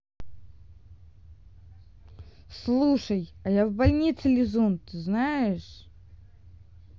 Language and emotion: Russian, neutral